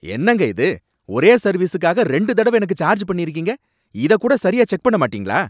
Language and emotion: Tamil, angry